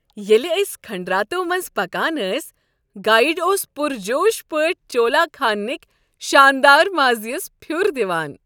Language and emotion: Kashmiri, happy